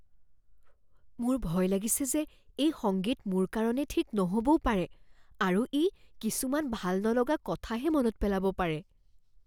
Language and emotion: Assamese, fearful